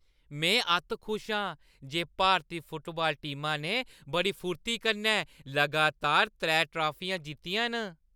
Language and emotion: Dogri, happy